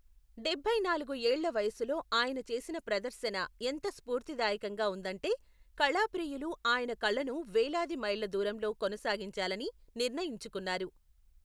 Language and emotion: Telugu, neutral